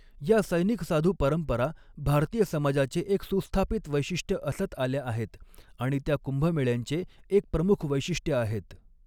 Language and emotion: Marathi, neutral